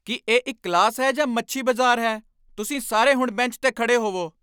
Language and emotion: Punjabi, angry